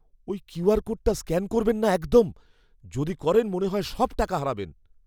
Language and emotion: Bengali, fearful